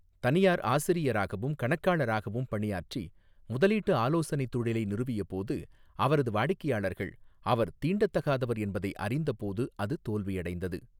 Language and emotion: Tamil, neutral